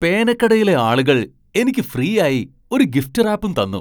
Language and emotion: Malayalam, surprised